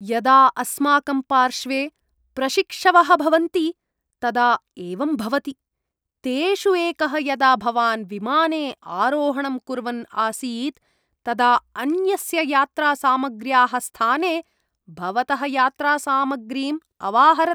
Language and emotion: Sanskrit, disgusted